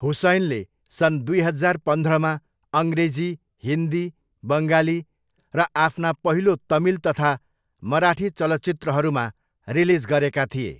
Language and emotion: Nepali, neutral